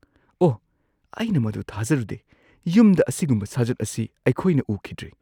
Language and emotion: Manipuri, surprised